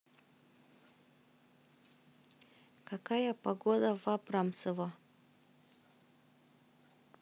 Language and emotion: Russian, neutral